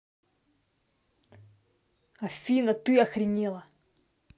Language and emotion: Russian, angry